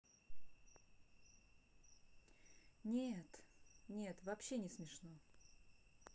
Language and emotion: Russian, neutral